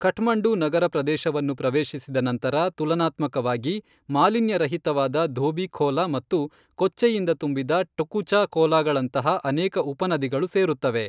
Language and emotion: Kannada, neutral